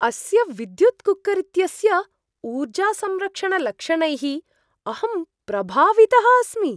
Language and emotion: Sanskrit, surprised